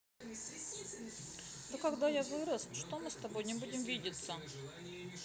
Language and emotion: Russian, sad